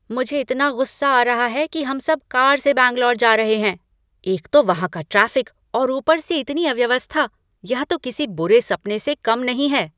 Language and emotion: Hindi, angry